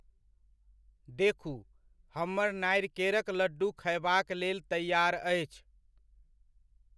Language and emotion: Maithili, neutral